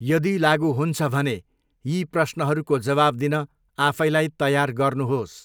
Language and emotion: Nepali, neutral